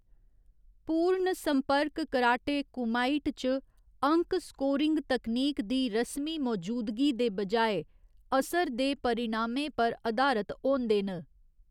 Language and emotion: Dogri, neutral